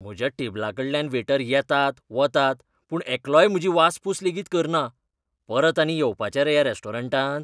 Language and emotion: Goan Konkani, disgusted